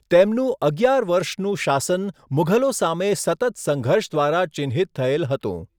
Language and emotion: Gujarati, neutral